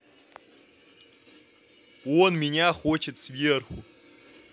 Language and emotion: Russian, neutral